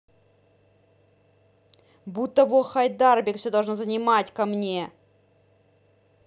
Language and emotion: Russian, angry